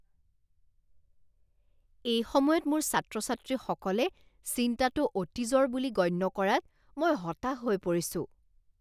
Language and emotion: Assamese, disgusted